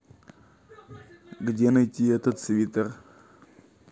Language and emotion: Russian, neutral